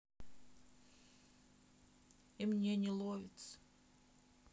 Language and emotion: Russian, sad